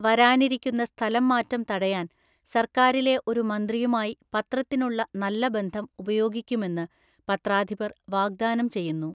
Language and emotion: Malayalam, neutral